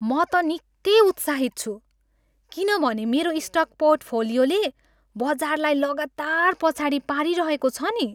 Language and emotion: Nepali, happy